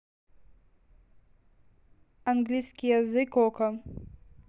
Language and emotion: Russian, neutral